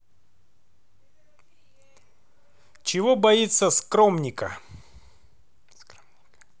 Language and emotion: Russian, neutral